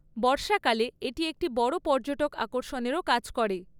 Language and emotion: Bengali, neutral